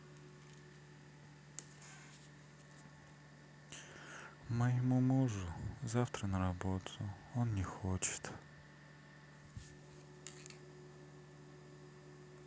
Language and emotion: Russian, sad